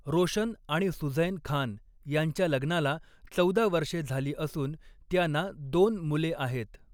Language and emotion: Marathi, neutral